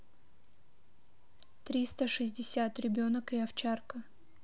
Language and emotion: Russian, neutral